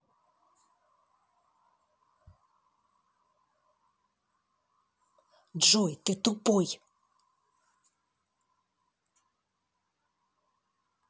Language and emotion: Russian, angry